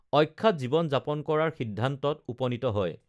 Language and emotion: Assamese, neutral